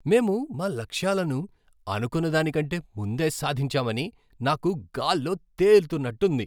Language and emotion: Telugu, happy